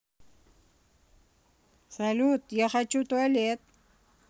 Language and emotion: Russian, neutral